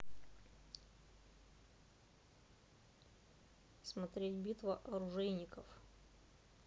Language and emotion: Russian, neutral